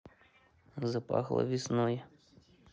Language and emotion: Russian, neutral